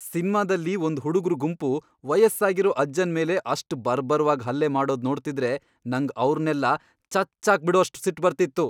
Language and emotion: Kannada, angry